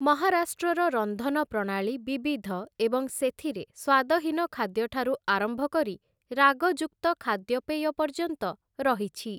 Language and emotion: Odia, neutral